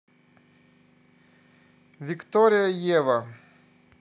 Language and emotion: Russian, neutral